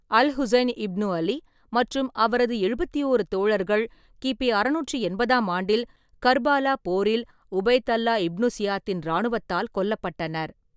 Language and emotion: Tamil, neutral